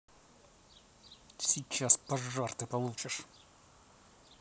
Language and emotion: Russian, angry